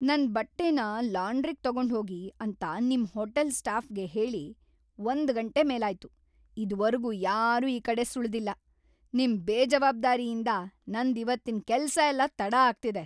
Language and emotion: Kannada, angry